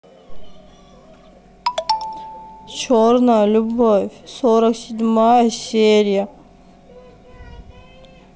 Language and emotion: Russian, sad